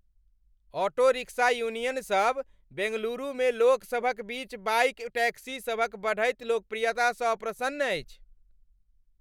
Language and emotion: Maithili, angry